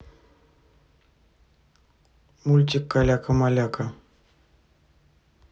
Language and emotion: Russian, neutral